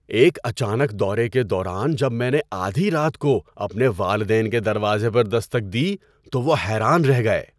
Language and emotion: Urdu, surprised